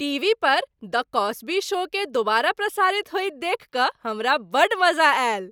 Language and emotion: Maithili, happy